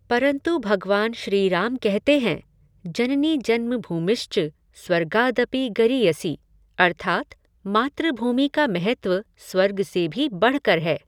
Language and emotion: Hindi, neutral